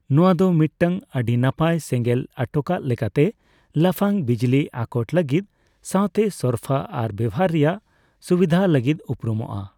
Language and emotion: Santali, neutral